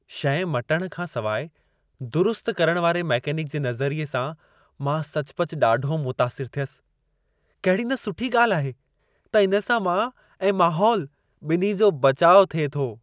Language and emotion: Sindhi, happy